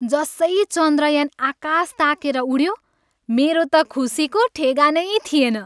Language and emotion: Nepali, happy